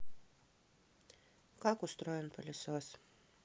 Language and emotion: Russian, neutral